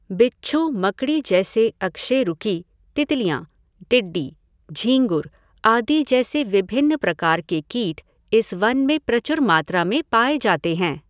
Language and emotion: Hindi, neutral